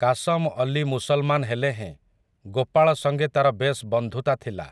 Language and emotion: Odia, neutral